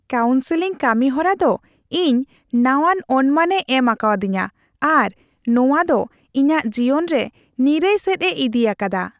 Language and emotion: Santali, happy